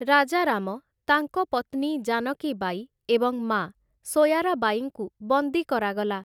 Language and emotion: Odia, neutral